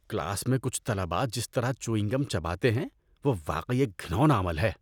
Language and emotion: Urdu, disgusted